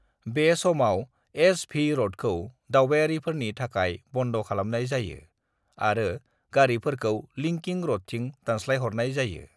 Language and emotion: Bodo, neutral